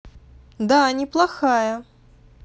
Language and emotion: Russian, positive